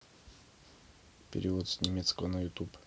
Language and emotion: Russian, neutral